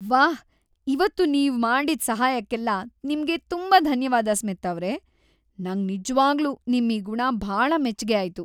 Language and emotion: Kannada, happy